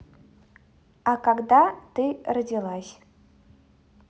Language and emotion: Russian, neutral